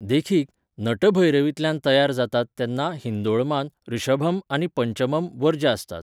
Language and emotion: Goan Konkani, neutral